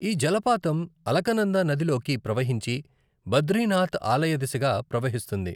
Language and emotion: Telugu, neutral